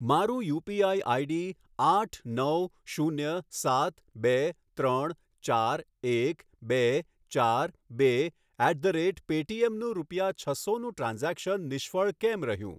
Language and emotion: Gujarati, neutral